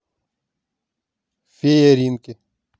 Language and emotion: Russian, neutral